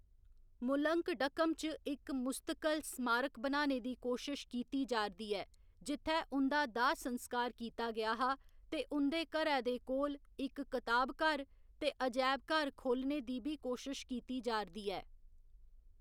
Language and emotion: Dogri, neutral